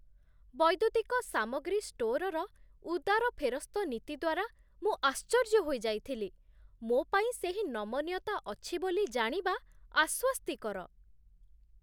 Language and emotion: Odia, surprised